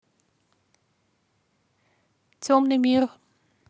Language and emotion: Russian, neutral